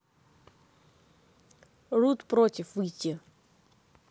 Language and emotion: Russian, neutral